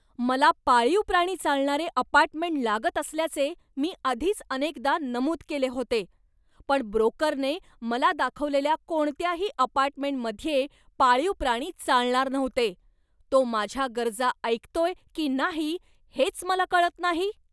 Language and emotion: Marathi, angry